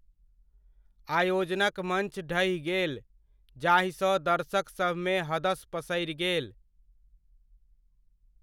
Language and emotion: Maithili, neutral